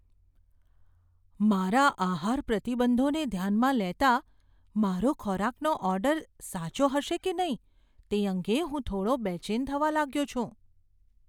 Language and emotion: Gujarati, fearful